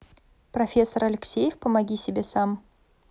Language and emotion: Russian, neutral